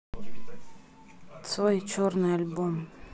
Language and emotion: Russian, neutral